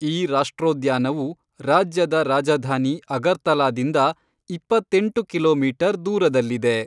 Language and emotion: Kannada, neutral